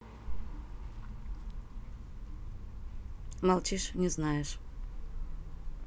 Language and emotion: Russian, neutral